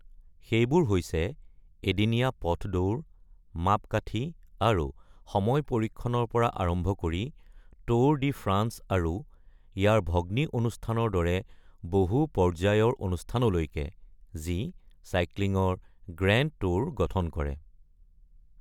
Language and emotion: Assamese, neutral